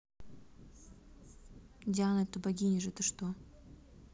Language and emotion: Russian, neutral